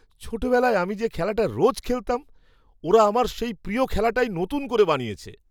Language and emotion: Bengali, surprised